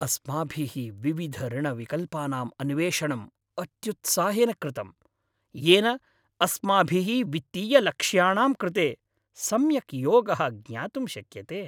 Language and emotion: Sanskrit, happy